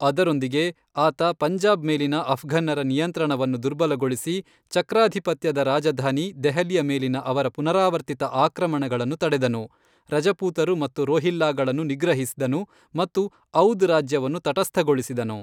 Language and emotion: Kannada, neutral